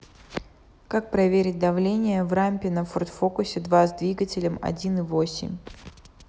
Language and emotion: Russian, neutral